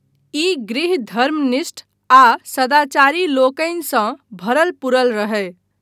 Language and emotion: Maithili, neutral